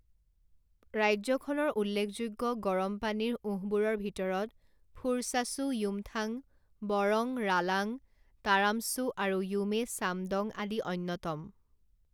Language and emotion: Assamese, neutral